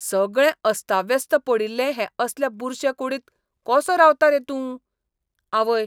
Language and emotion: Goan Konkani, disgusted